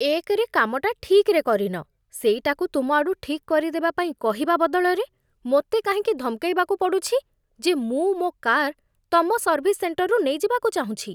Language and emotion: Odia, disgusted